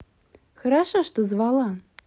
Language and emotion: Russian, positive